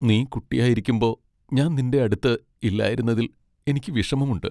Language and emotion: Malayalam, sad